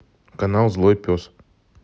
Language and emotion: Russian, neutral